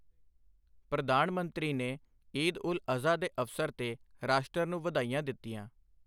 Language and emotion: Punjabi, neutral